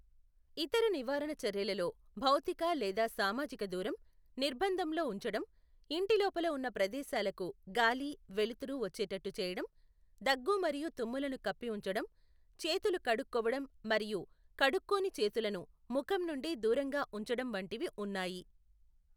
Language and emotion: Telugu, neutral